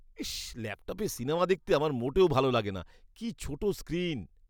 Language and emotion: Bengali, disgusted